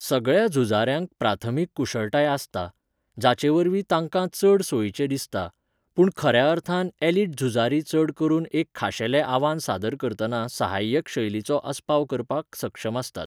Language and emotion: Goan Konkani, neutral